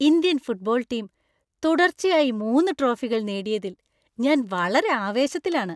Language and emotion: Malayalam, happy